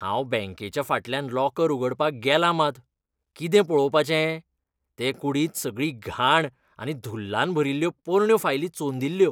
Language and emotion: Goan Konkani, disgusted